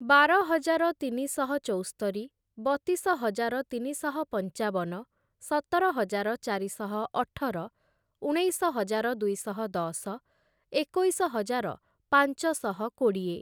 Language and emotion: Odia, neutral